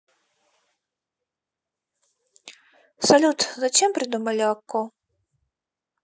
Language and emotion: Russian, sad